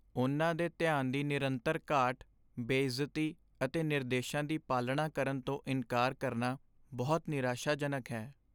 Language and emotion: Punjabi, sad